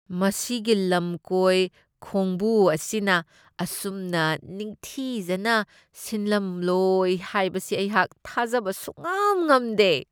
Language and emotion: Manipuri, disgusted